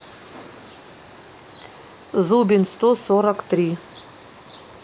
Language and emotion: Russian, neutral